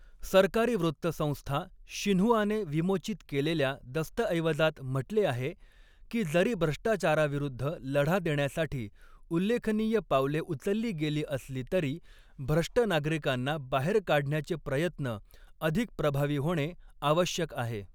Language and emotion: Marathi, neutral